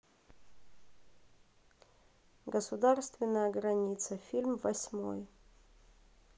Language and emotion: Russian, neutral